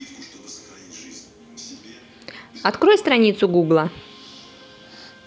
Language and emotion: Russian, neutral